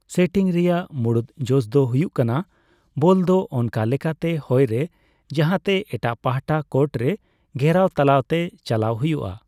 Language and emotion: Santali, neutral